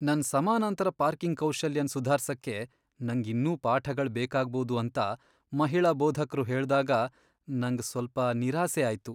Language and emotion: Kannada, sad